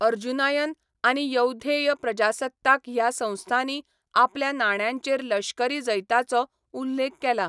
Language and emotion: Goan Konkani, neutral